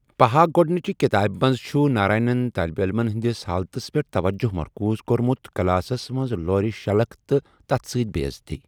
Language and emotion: Kashmiri, neutral